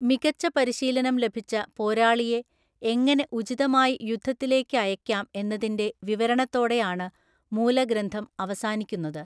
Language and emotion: Malayalam, neutral